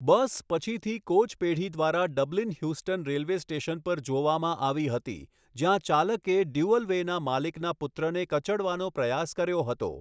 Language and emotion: Gujarati, neutral